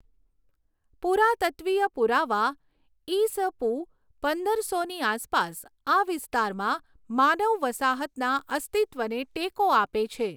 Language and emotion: Gujarati, neutral